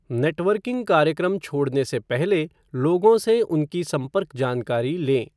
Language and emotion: Hindi, neutral